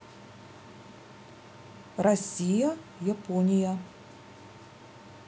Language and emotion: Russian, neutral